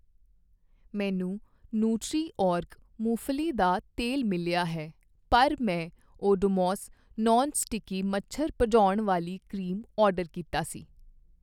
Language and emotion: Punjabi, neutral